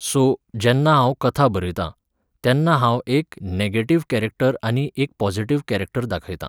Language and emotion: Goan Konkani, neutral